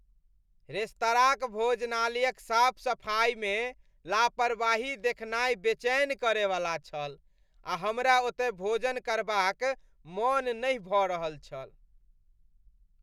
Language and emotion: Maithili, disgusted